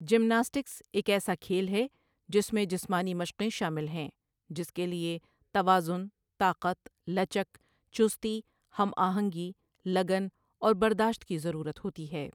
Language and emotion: Urdu, neutral